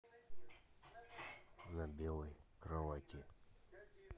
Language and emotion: Russian, neutral